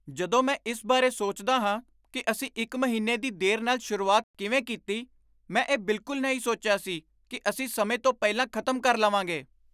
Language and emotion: Punjabi, surprised